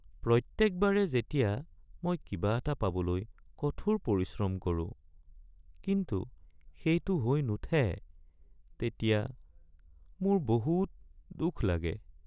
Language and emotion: Assamese, sad